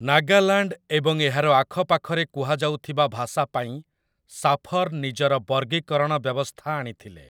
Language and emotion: Odia, neutral